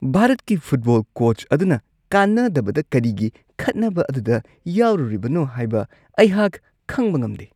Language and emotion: Manipuri, disgusted